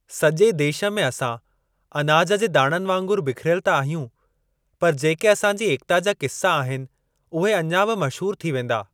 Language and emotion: Sindhi, neutral